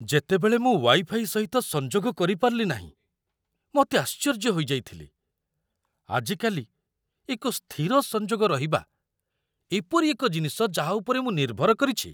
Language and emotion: Odia, surprised